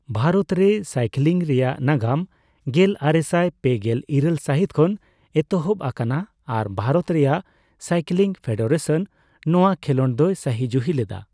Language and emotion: Santali, neutral